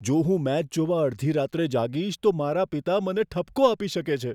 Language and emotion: Gujarati, fearful